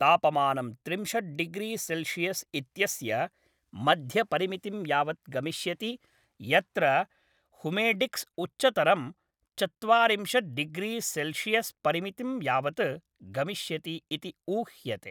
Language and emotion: Sanskrit, neutral